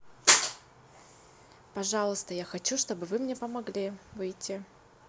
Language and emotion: Russian, neutral